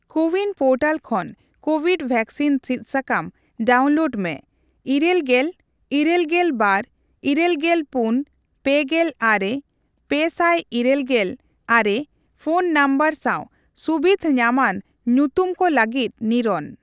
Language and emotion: Santali, neutral